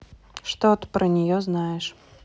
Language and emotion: Russian, neutral